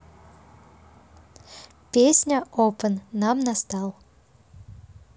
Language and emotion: Russian, positive